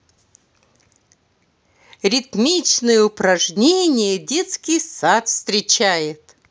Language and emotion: Russian, positive